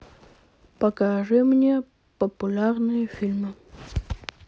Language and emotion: Russian, neutral